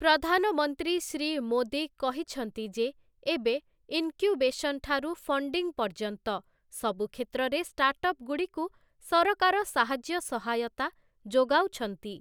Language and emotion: Odia, neutral